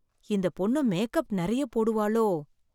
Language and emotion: Tamil, fearful